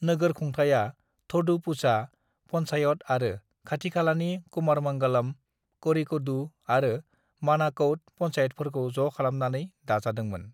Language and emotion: Bodo, neutral